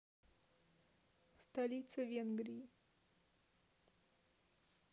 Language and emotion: Russian, neutral